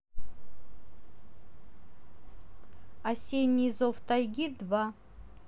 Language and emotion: Russian, neutral